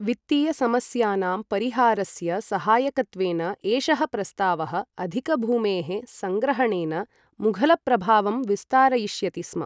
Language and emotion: Sanskrit, neutral